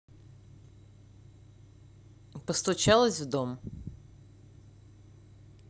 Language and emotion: Russian, neutral